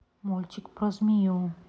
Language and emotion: Russian, neutral